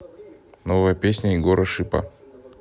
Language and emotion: Russian, neutral